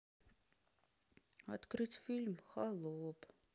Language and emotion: Russian, sad